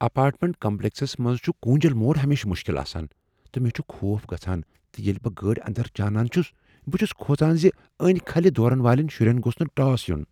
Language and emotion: Kashmiri, fearful